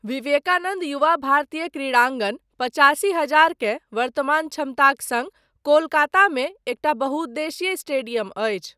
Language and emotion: Maithili, neutral